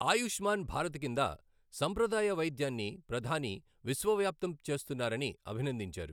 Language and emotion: Telugu, neutral